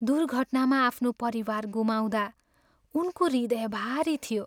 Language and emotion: Nepali, sad